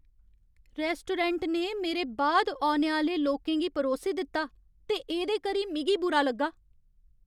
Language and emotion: Dogri, angry